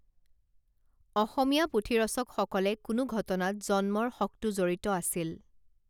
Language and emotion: Assamese, neutral